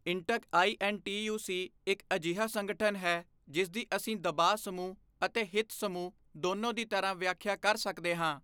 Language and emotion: Punjabi, neutral